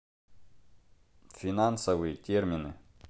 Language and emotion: Russian, neutral